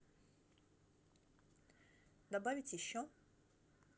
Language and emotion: Russian, neutral